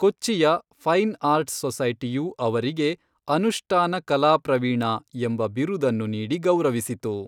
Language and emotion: Kannada, neutral